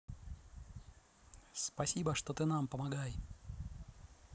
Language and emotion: Russian, positive